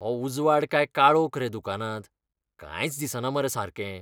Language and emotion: Goan Konkani, disgusted